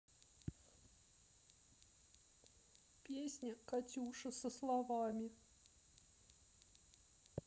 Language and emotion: Russian, sad